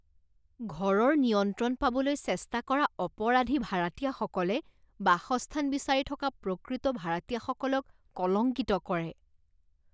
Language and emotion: Assamese, disgusted